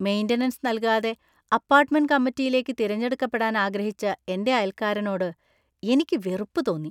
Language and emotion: Malayalam, disgusted